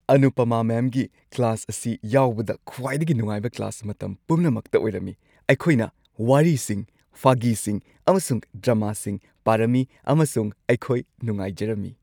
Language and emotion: Manipuri, happy